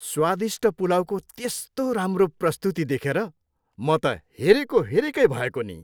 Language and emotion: Nepali, happy